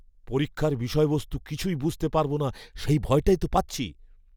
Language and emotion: Bengali, fearful